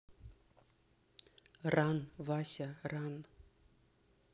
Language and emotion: Russian, neutral